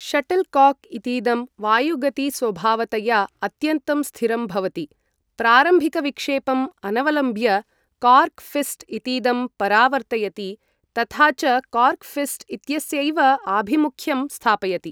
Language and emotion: Sanskrit, neutral